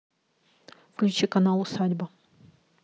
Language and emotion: Russian, neutral